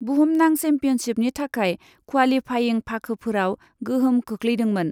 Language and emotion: Bodo, neutral